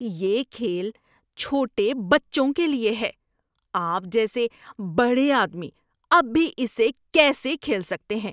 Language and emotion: Urdu, disgusted